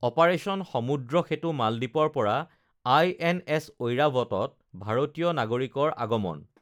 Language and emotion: Assamese, neutral